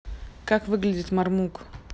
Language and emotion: Russian, neutral